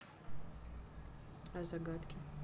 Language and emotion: Russian, neutral